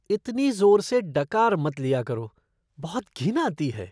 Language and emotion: Hindi, disgusted